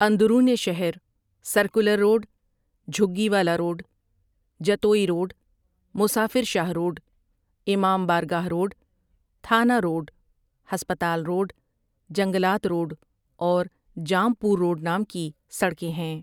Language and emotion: Urdu, neutral